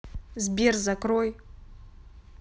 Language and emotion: Russian, angry